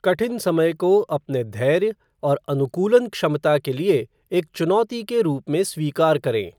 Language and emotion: Hindi, neutral